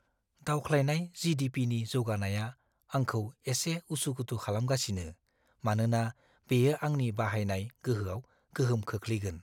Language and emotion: Bodo, fearful